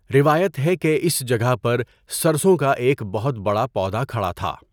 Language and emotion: Urdu, neutral